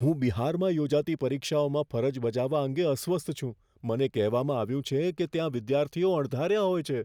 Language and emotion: Gujarati, fearful